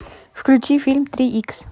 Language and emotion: Russian, neutral